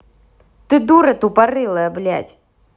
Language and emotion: Russian, angry